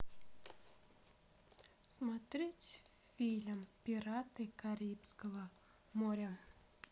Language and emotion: Russian, neutral